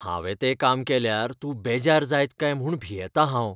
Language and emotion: Goan Konkani, fearful